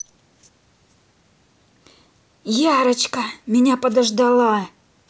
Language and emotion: Russian, neutral